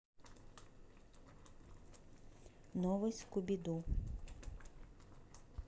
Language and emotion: Russian, neutral